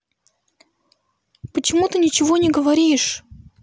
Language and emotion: Russian, neutral